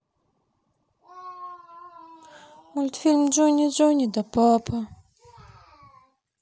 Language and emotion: Russian, sad